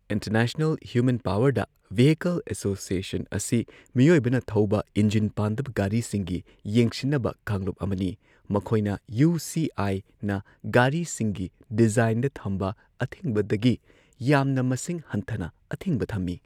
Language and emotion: Manipuri, neutral